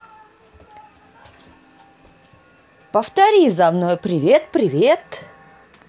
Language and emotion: Russian, positive